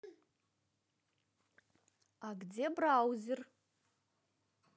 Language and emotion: Russian, neutral